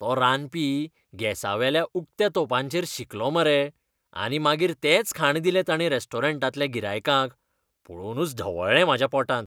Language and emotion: Goan Konkani, disgusted